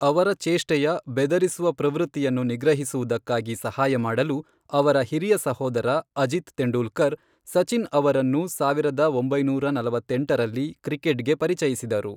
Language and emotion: Kannada, neutral